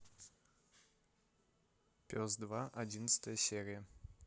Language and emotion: Russian, neutral